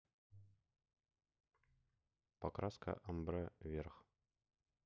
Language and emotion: Russian, neutral